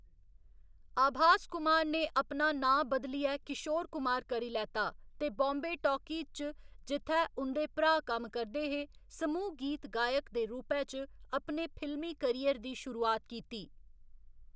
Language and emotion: Dogri, neutral